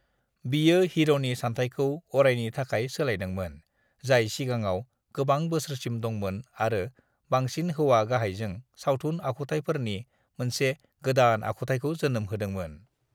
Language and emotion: Bodo, neutral